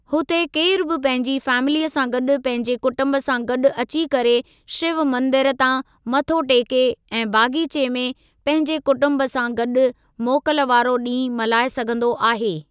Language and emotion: Sindhi, neutral